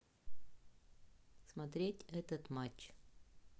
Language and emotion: Russian, neutral